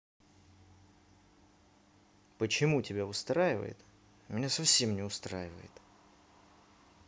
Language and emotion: Russian, angry